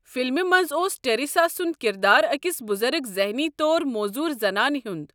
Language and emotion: Kashmiri, neutral